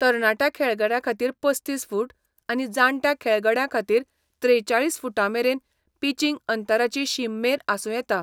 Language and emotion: Goan Konkani, neutral